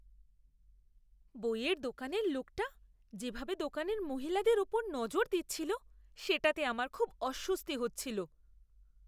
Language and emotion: Bengali, disgusted